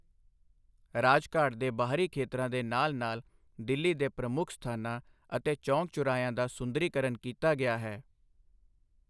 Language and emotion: Punjabi, neutral